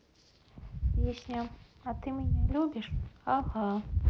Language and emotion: Russian, neutral